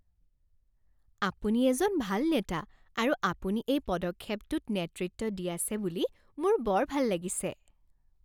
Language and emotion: Assamese, happy